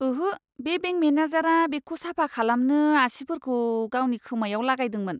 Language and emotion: Bodo, disgusted